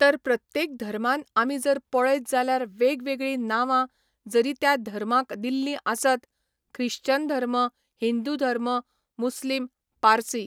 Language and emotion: Goan Konkani, neutral